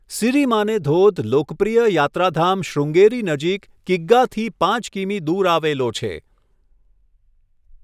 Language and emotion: Gujarati, neutral